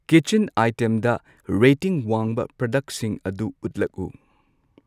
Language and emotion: Manipuri, neutral